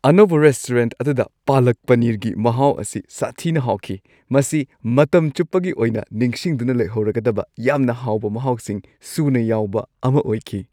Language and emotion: Manipuri, happy